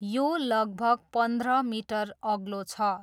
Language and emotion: Nepali, neutral